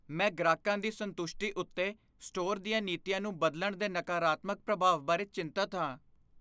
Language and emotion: Punjabi, fearful